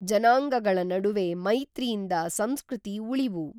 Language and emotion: Kannada, neutral